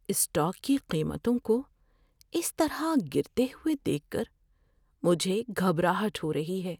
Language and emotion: Urdu, fearful